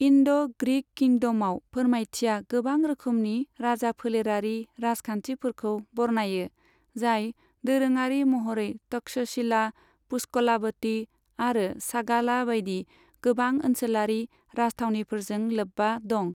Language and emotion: Bodo, neutral